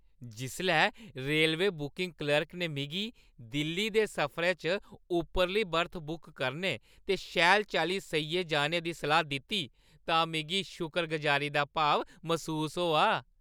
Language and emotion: Dogri, happy